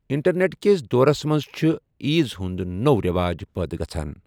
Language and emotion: Kashmiri, neutral